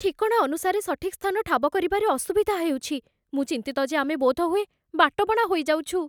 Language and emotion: Odia, fearful